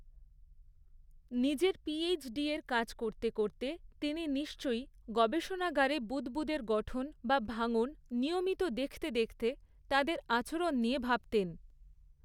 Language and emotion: Bengali, neutral